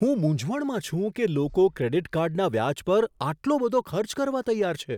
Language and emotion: Gujarati, surprised